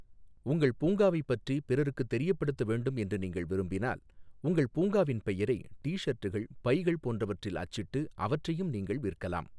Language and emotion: Tamil, neutral